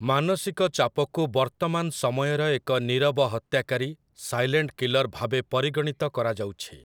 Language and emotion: Odia, neutral